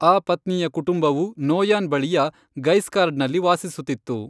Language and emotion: Kannada, neutral